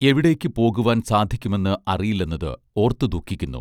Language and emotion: Malayalam, neutral